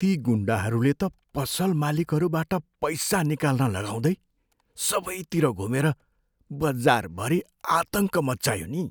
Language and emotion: Nepali, fearful